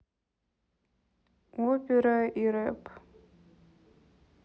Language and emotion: Russian, neutral